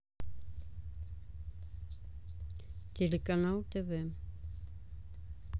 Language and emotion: Russian, neutral